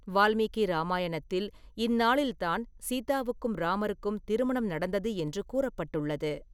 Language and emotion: Tamil, neutral